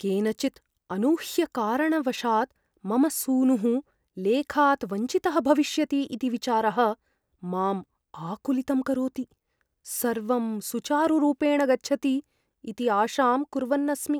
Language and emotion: Sanskrit, fearful